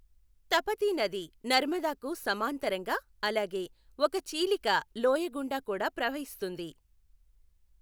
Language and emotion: Telugu, neutral